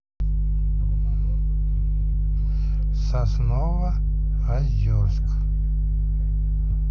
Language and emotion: Russian, neutral